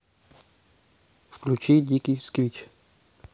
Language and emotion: Russian, neutral